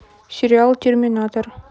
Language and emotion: Russian, neutral